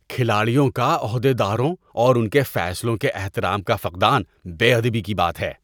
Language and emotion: Urdu, disgusted